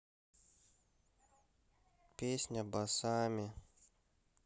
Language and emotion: Russian, sad